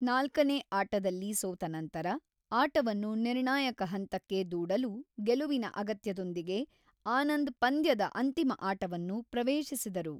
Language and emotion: Kannada, neutral